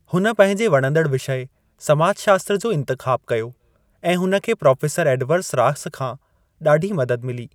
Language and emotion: Sindhi, neutral